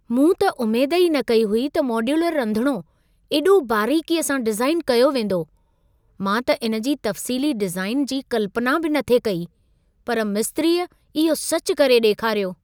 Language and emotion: Sindhi, surprised